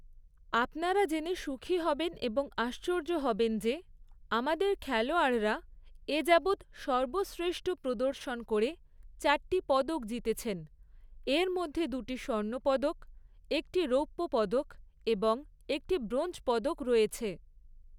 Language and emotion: Bengali, neutral